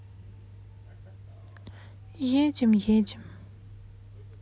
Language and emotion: Russian, sad